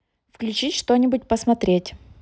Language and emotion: Russian, neutral